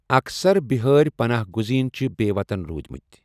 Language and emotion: Kashmiri, neutral